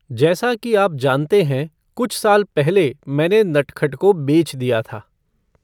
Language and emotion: Hindi, neutral